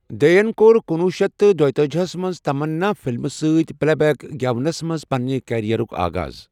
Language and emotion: Kashmiri, neutral